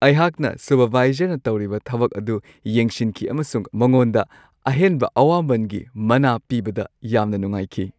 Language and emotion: Manipuri, happy